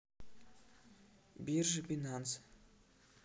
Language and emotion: Russian, neutral